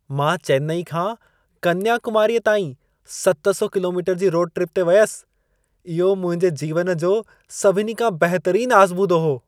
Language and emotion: Sindhi, happy